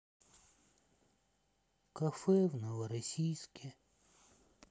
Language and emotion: Russian, sad